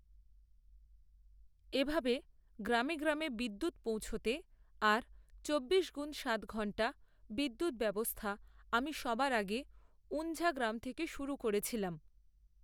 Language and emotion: Bengali, neutral